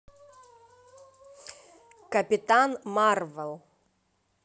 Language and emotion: Russian, positive